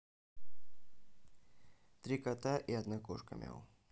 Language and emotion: Russian, neutral